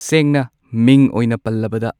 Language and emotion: Manipuri, neutral